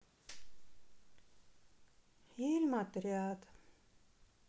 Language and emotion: Russian, sad